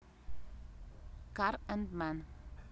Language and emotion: Russian, neutral